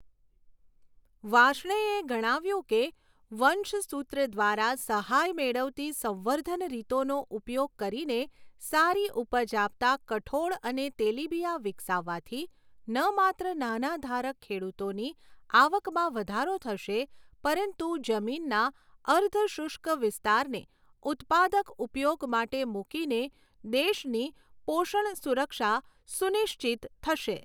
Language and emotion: Gujarati, neutral